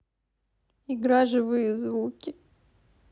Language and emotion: Russian, sad